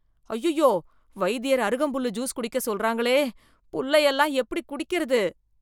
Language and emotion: Tamil, disgusted